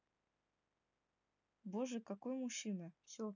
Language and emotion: Russian, neutral